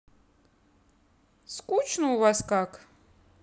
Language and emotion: Russian, neutral